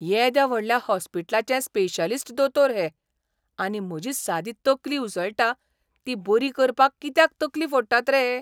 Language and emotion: Goan Konkani, surprised